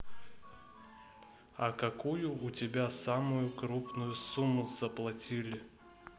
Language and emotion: Russian, neutral